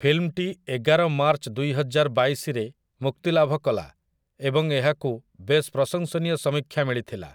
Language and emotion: Odia, neutral